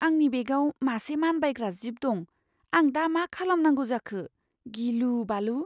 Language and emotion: Bodo, fearful